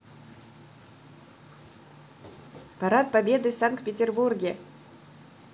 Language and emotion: Russian, positive